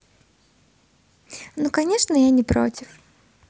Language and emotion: Russian, positive